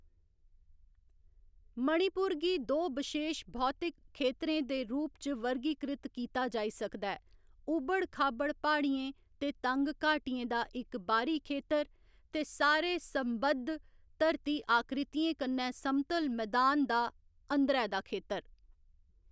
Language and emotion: Dogri, neutral